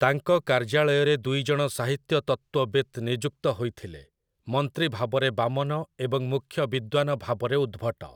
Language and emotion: Odia, neutral